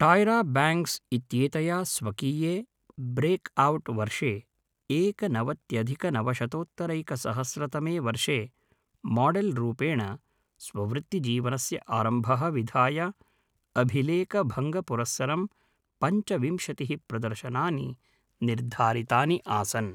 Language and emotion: Sanskrit, neutral